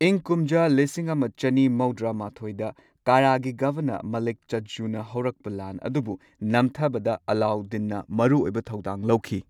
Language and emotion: Manipuri, neutral